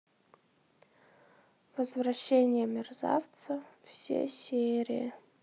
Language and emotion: Russian, sad